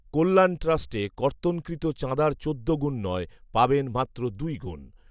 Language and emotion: Bengali, neutral